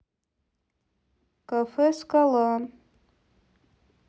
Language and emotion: Russian, neutral